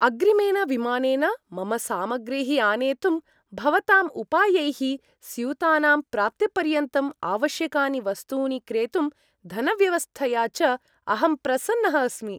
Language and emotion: Sanskrit, happy